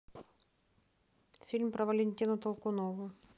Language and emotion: Russian, neutral